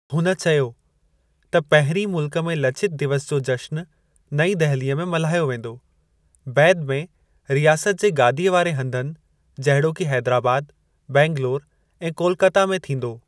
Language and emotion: Sindhi, neutral